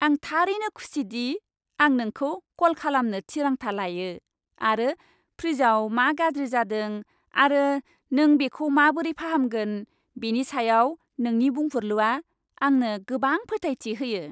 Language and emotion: Bodo, happy